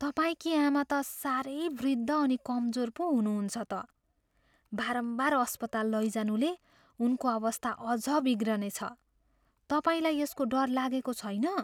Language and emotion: Nepali, fearful